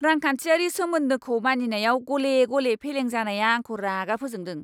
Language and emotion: Bodo, angry